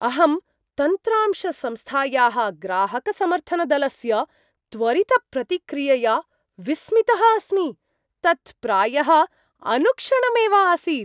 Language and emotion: Sanskrit, surprised